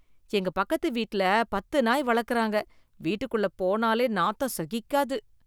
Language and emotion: Tamil, disgusted